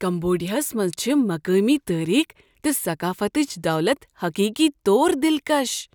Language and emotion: Kashmiri, surprised